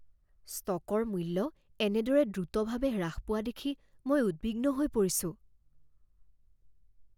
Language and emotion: Assamese, fearful